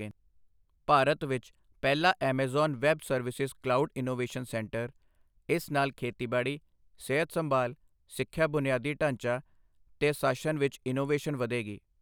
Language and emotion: Punjabi, neutral